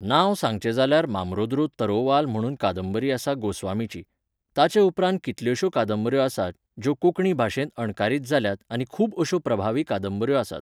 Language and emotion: Goan Konkani, neutral